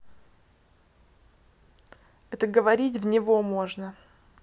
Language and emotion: Russian, neutral